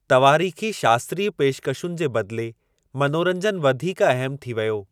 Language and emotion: Sindhi, neutral